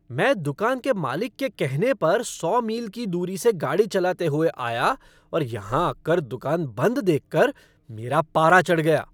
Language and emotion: Hindi, angry